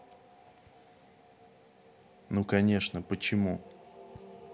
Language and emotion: Russian, neutral